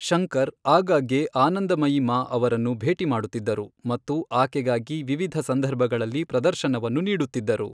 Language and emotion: Kannada, neutral